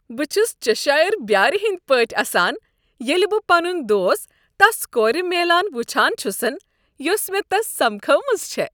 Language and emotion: Kashmiri, happy